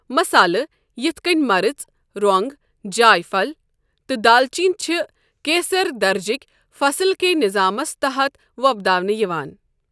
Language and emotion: Kashmiri, neutral